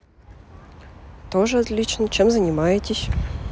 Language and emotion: Russian, neutral